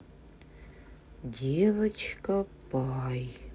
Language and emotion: Russian, sad